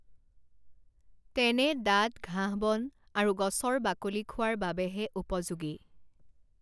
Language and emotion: Assamese, neutral